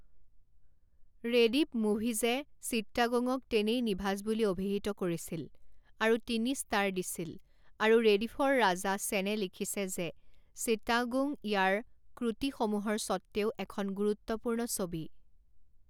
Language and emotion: Assamese, neutral